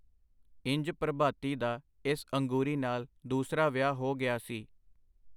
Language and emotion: Punjabi, neutral